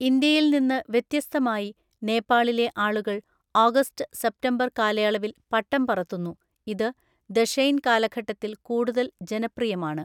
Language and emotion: Malayalam, neutral